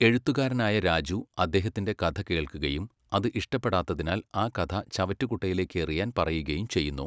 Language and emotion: Malayalam, neutral